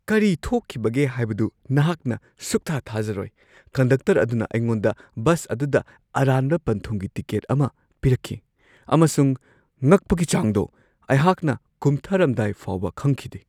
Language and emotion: Manipuri, surprised